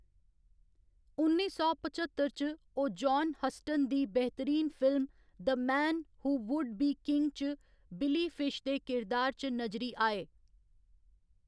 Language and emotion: Dogri, neutral